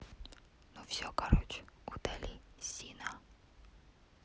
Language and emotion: Russian, neutral